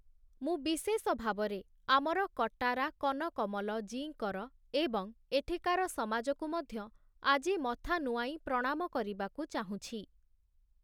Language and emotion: Odia, neutral